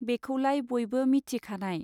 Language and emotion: Bodo, neutral